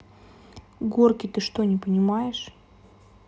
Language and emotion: Russian, neutral